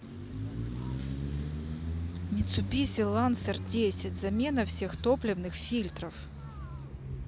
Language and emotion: Russian, neutral